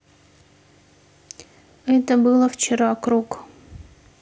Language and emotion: Russian, neutral